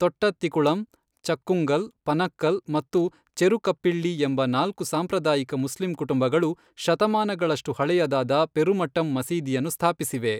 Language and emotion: Kannada, neutral